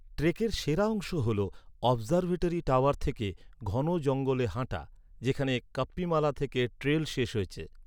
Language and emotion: Bengali, neutral